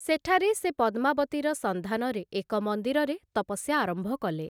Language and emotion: Odia, neutral